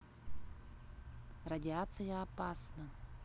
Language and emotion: Russian, neutral